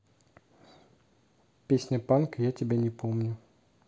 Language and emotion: Russian, neutral